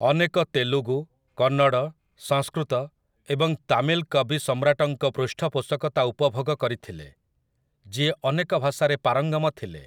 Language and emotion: Odia, neutral